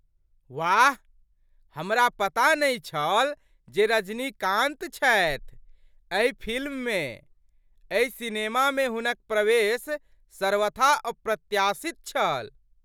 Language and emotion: Maithili, surprised